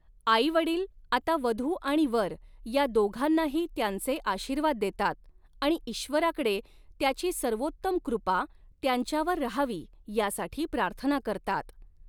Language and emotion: Marathi, neutral